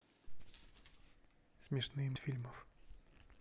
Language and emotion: Russian, neutral